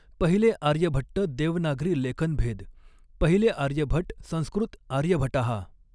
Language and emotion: Marathi, neutral